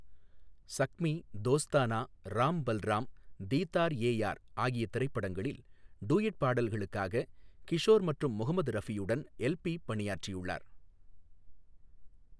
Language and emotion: Tamil, neutral